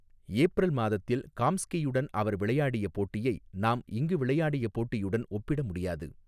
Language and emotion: Tamil, neutral